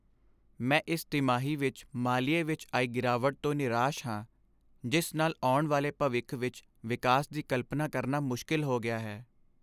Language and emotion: Punjabi, sad